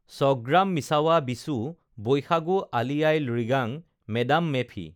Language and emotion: Assamese, neutral